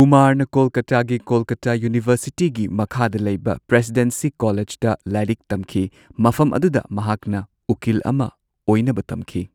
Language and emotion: Manipuri, neutral